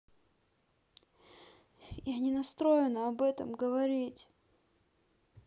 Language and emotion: Russian, sad